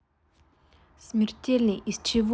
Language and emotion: Russian, neutral